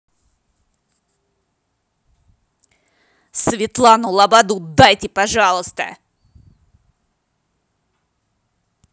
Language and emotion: Russian, angry